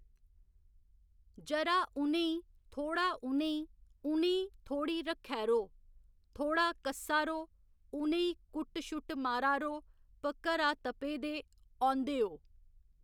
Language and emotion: Dogri, neutral